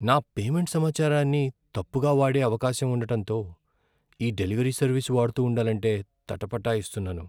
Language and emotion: Telugu, fearful